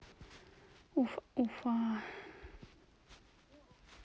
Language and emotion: Russian, neutral